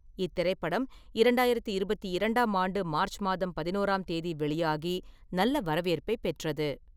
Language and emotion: Tamil, neutral